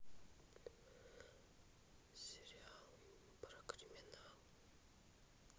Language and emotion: Russian, neutral